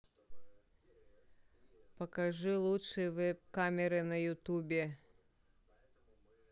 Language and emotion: Russian, neutral